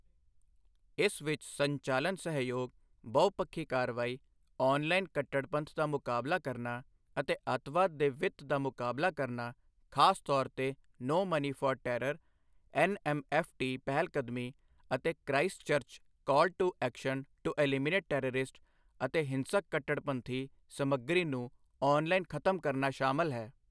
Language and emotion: Punjabi, neutral